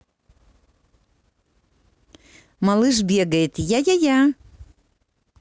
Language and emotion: Russian, positive